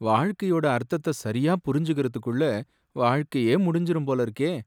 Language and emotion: Tamil, sad